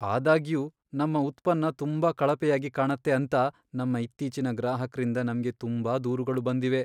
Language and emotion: Kannada, sad